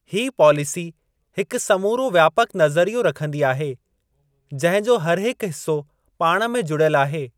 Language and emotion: Sindhi, neutral